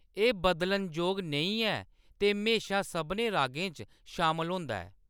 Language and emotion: Dogri, neutral